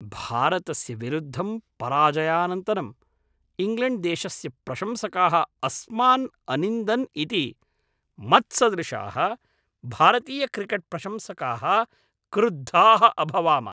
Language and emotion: Sanskrit, angry